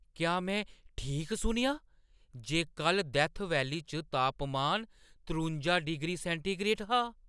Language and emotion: Dogri, surprised